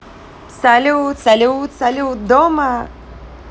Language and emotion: Russian, positive